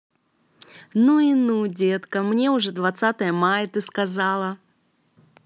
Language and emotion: Russian, positive